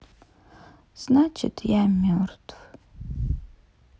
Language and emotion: Russian, sad